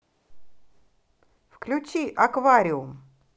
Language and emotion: Russian, positive